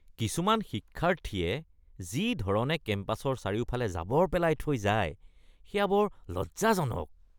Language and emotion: Assamese, disgusted